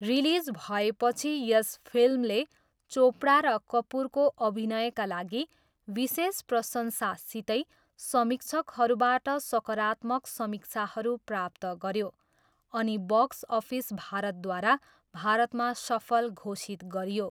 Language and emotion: Nepali, neutral